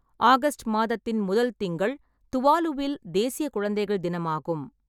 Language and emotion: Tamil, neutral